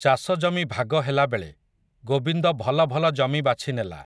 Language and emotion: Odia, neutral